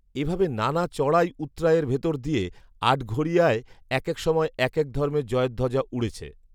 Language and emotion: Bengali, neutral